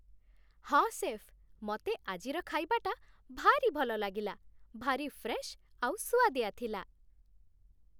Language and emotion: Odia, happy